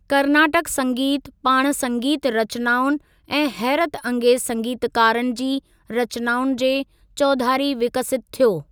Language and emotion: Sindhi, neutral